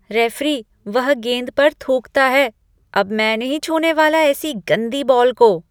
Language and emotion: Hindi, disgusted